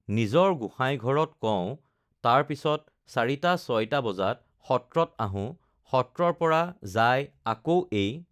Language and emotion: Assamese, neutral